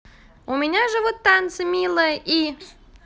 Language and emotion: Russian, positive